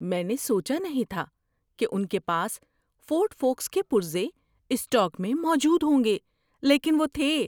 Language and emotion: Urdu, surprised